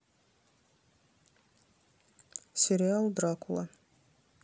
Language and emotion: Russian, neutral